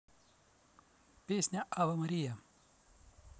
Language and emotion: Russian, neutral